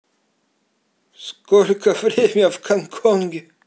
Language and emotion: Russian, neutral